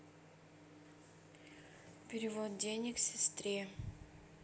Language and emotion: Russian, neutral